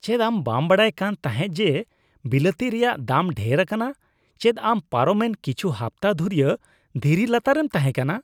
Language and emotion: Santali, disgusted